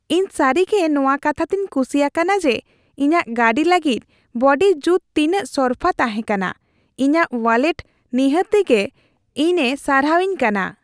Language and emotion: Santali, happy